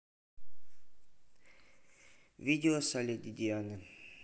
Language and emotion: Russian, neutral